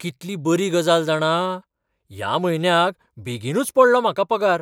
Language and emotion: Goan Konkani, surprised